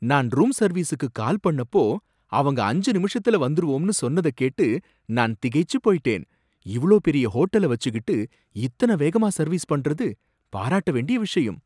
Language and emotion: Tamil, surprised